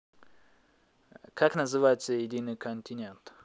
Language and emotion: Russian, neutral